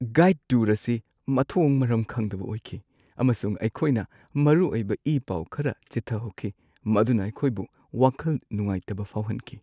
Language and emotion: Manipuri, sad